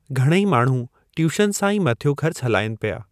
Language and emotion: Sindhi, neutral